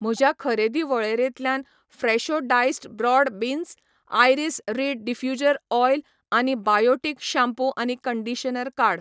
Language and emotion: Goan Konkani, neutral